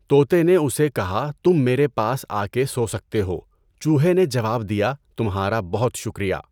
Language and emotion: Urdu, neutral